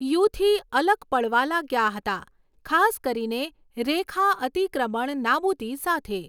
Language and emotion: Gujarati, neutral